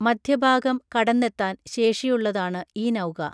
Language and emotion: Malayalam, neutral